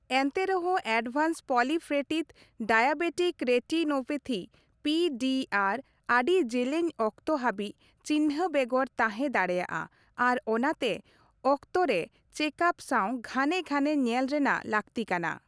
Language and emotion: Santali, neutral